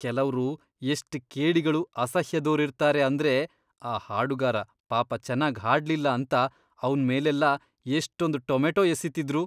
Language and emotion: Kannada, disgusted